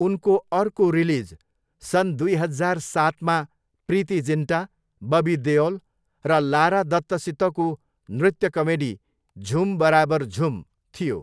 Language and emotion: Nepali, neutral